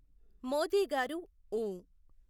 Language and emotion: Telugu, neutral